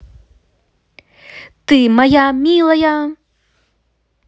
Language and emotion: Russian, positive